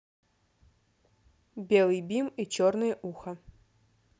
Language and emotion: Russian, neutral